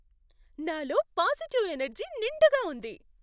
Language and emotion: Telugu, happy